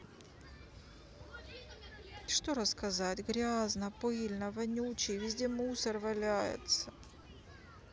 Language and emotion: Russian, sad